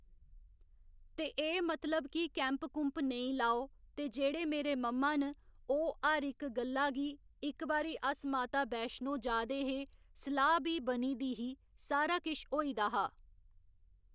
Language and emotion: Dogri, neutral